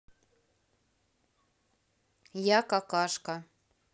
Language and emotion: Russian, neutral